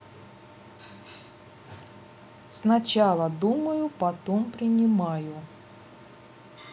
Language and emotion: Russian, neutral